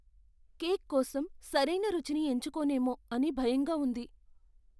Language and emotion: Telugu, fearful